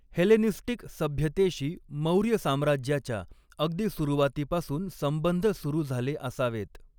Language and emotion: Marathi, neutral